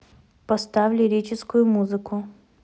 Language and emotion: Russian, neutral